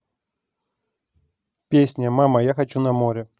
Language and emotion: Russian, neutral